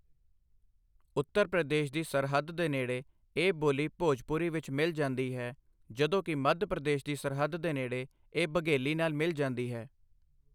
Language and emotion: Punjabi, neutral